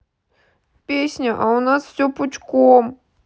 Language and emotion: Russian, sad